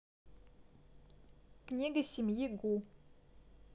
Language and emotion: Russian, neutral